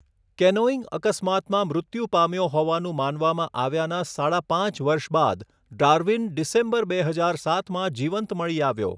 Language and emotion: Gujarati, neutral